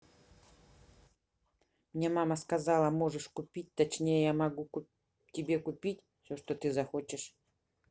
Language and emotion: Russian, neutral